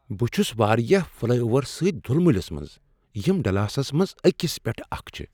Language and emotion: Kashmiri, surprised